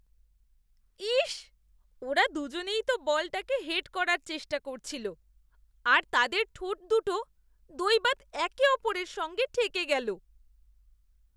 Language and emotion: Bengali, disgusted